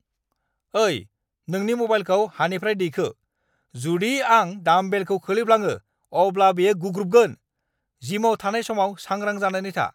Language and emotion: Bodo, angry